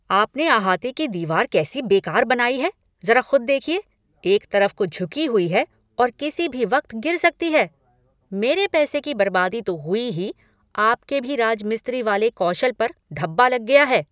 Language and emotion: Hindi, angry